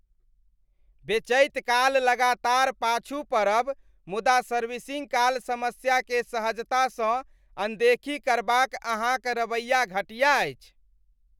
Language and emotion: Maithili, disgusted